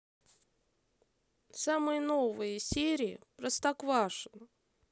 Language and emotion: Russian, neutral